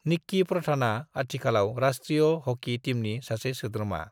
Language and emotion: Bodo, neutral